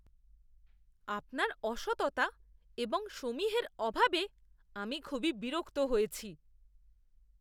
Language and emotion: Bengali, disgusted